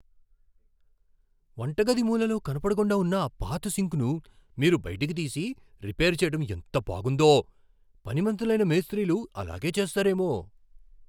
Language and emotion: Telugu, surprised